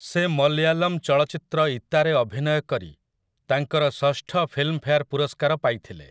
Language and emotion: Odia, neutral